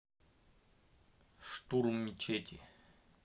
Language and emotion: Russian, neutral